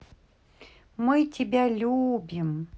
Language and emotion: Russian, positive